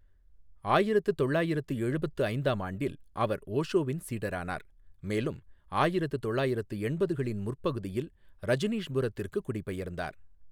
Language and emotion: Tamil, neutral